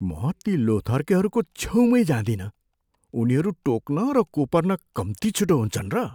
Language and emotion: Nepali, fearful